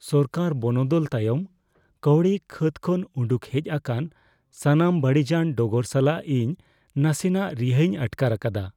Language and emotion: Santali, fearful